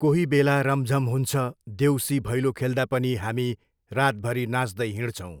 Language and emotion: Nepali, neutral